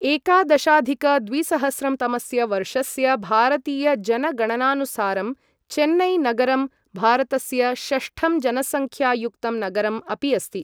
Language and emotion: Sanskrit, neutral